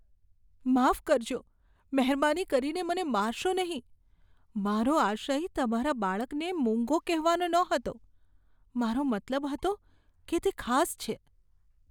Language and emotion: Gujarati, fearful